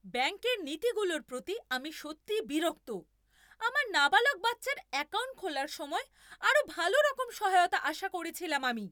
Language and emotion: Bengali, angry